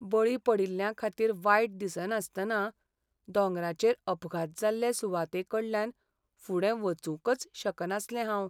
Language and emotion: Goan Konkani, sad